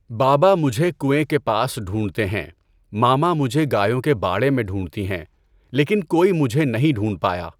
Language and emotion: Urdu, neutral